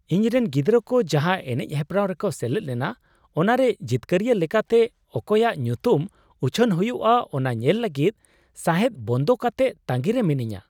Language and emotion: Santali, surprised